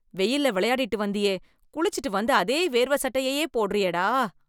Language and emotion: Tamil, disgusted